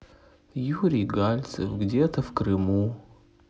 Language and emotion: Russian, sad